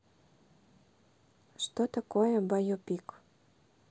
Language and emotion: Russian, neutral